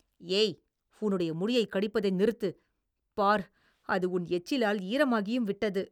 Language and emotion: Tamil, disgusted